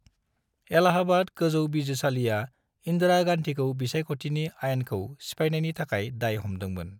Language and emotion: Bodo, neutral